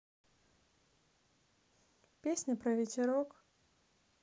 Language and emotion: Russian, neutral